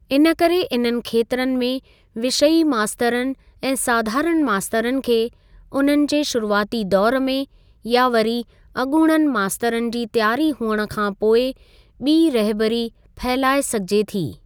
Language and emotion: Sindhi, neutral